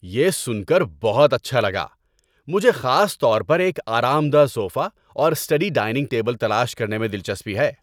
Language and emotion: Urdu, happy